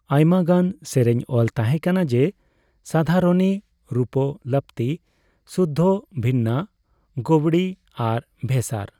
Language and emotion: Santali, neutral